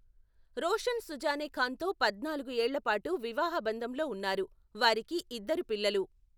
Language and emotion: Telugu, neutral